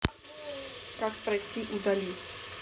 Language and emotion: Russian, neutral